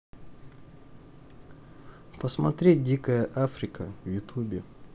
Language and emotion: Russian, neutral